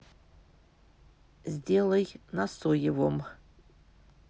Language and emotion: Russian, neutral